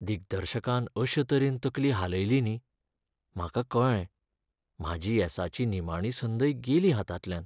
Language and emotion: Goan Konkani, sad